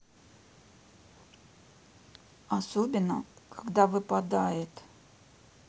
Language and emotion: Russian, neutral